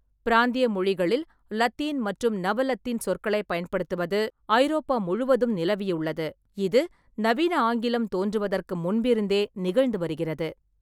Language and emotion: Tamil, neutral